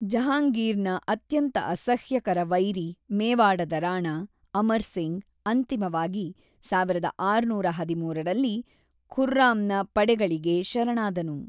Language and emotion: Kannada, neutral